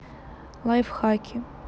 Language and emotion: Russian, neutral